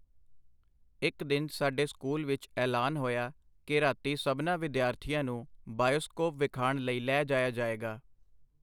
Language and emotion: Punjabi, neutral